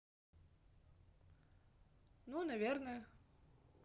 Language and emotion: Russian, neutral